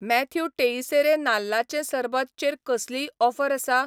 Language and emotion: Goan Konkani, neutral